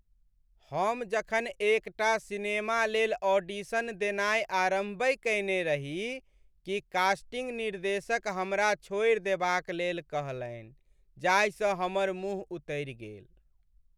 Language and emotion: Maithili, sad